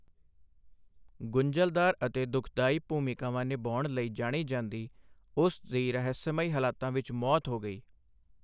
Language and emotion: Punjabi, neutral